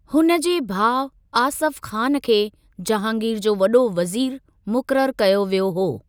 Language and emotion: Sindhi, neutral